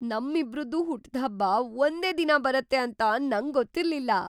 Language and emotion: Kannada, surprised